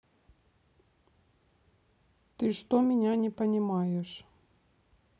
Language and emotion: Russian, neutral